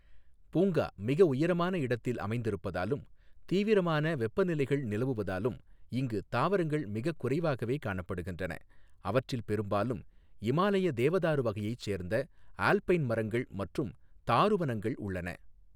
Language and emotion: Tamil, neutral